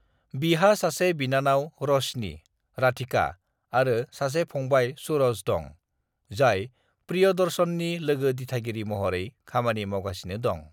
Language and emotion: Bodo, neutral